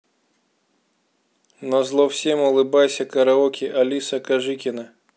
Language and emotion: Russian, neutral